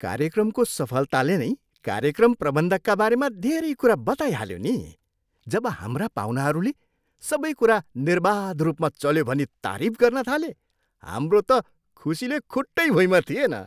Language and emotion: Nepali, happy